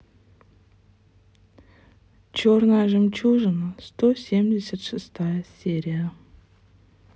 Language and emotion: Russian, sad